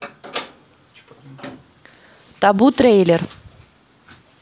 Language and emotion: Russian, neutral